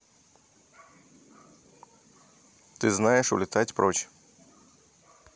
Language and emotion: Russian, neutral